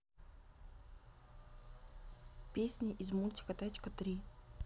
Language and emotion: Russian, neutral